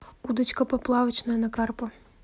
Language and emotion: Russian, neutral